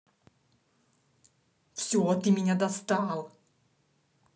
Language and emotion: Russian, angry